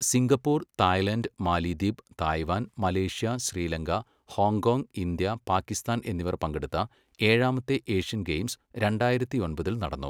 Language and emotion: Malayalam, neutral